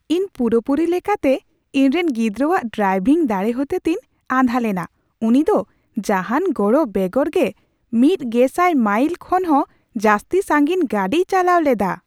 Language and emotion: Santali, surprised